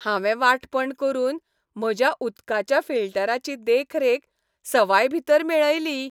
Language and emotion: Goan Konkani, happy